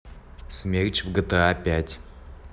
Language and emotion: Russian, neutral